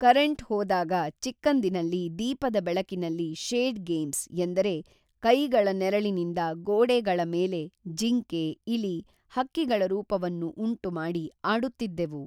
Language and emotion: Kannada, neutral